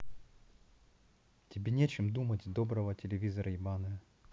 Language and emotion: Russian, neutral